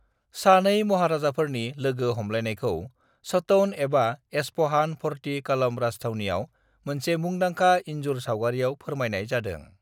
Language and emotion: Bodo, neutral